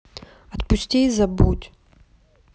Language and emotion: Russian, neutral